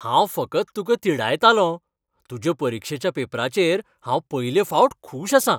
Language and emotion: Goan Konkani, happy